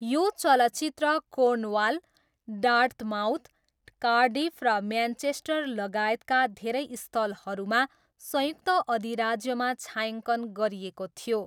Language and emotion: Nepali, neutral